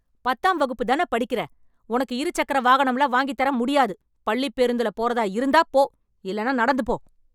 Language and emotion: Tamil, angry